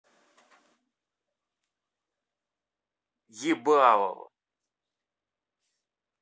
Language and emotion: Russian, angry